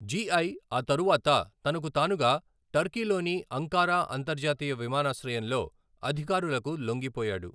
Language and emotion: Telugu, neutral